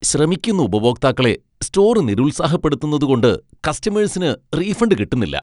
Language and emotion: Malayalam, disgusted